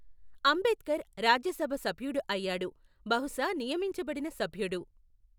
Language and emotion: Telugu, neutral